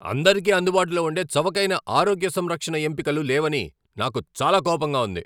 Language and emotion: Telugu, angry